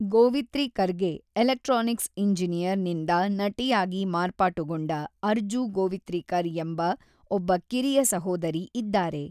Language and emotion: Kannada, neutral